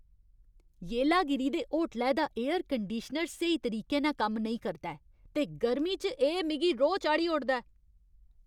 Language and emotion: Dogri, angry